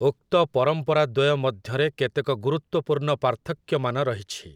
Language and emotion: Odia, neutral